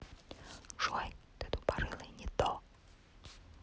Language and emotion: Russian, neutral